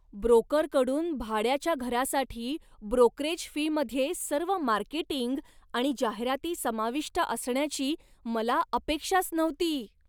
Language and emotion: Marathi, surprised